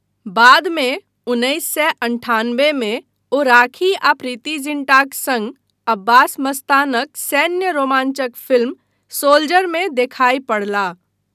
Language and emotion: Maithili, neutral